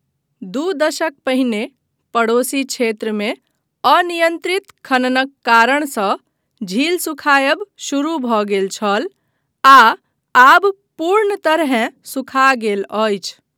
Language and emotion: Maithili, neutral